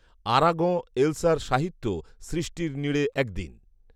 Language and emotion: Bengali, neutral